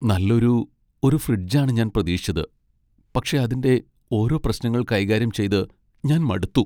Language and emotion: Malayalam, sad